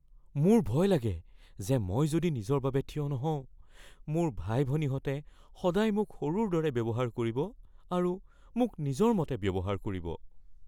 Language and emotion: Assamese, fearful